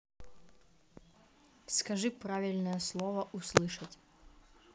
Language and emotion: Russian, neutral